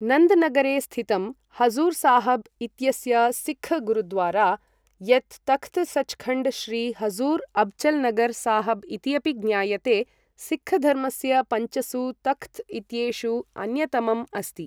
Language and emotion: Sanskrit, neutral